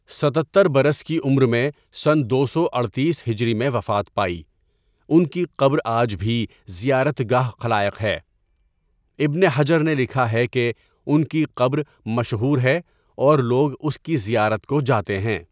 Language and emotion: Urdu, neutral